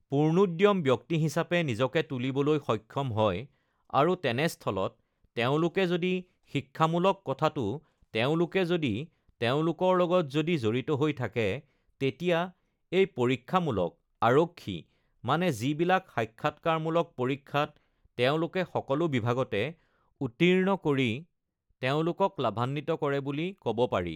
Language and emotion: Assamese, neutral